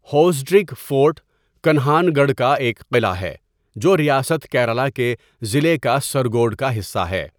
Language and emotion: Urdu, neutral